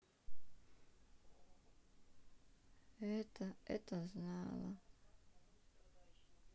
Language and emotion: Russian, sad